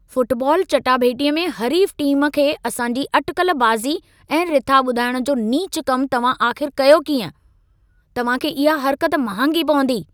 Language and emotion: Sindhi, angry